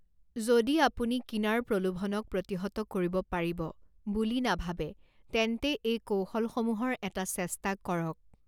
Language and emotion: Assamese, neutral